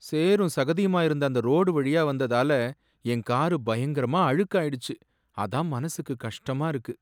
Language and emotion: Tamil, sad